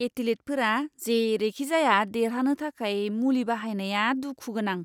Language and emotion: Bodo, disgusted